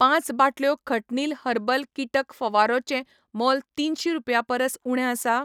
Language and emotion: Goan Konkani, neutral